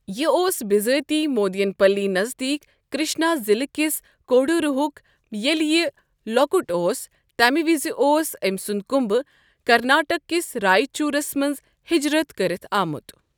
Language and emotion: Kashmiri, neutral